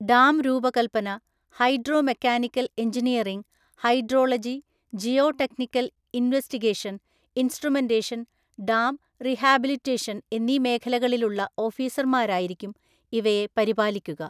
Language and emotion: Malayalam, neutral